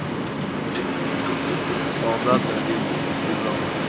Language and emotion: Russian, neutral